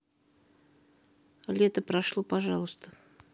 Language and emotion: Russian, neutral